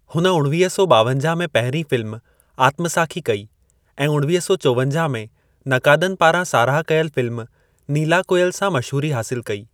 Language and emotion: Sindhi, neutral